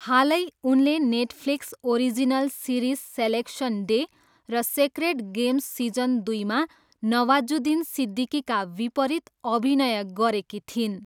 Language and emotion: Nepali, neutral